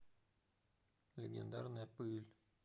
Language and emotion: Russian, neutral